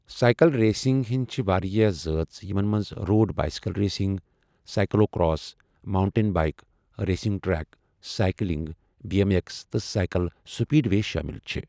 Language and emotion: Kashmiri, neutral